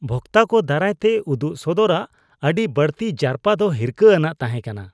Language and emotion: Santali, disgusted